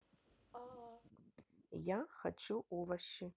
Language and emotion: Russian, neutral